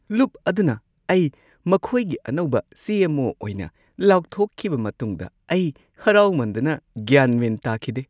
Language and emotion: Manipuri, happy